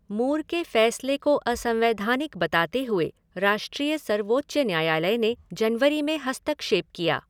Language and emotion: Hindi, neutral